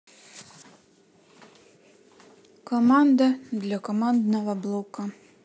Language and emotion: Russian, neutral